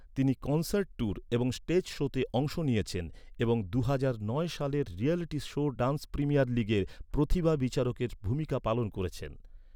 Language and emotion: Bengali, neutral